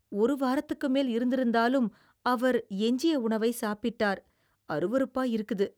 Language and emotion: Tamil, disgusted